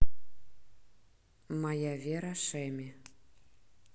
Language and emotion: Russian, neutral